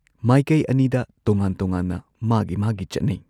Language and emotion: Manipuri, neutral